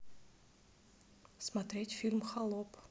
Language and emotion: Russian, neutral